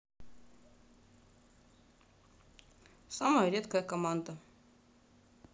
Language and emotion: Russian, neutral